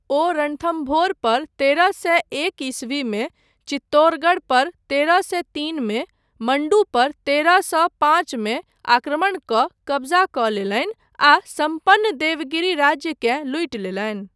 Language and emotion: Maithili, neutral